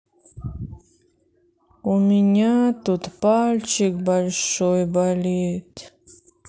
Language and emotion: Russian, sad